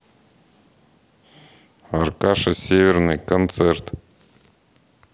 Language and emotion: Russian, neutral